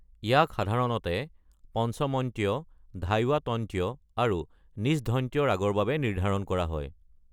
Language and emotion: Assamese, neutral